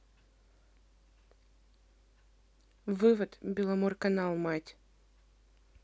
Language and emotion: Russian, neutral